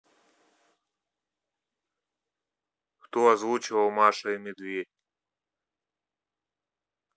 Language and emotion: Russian, neutral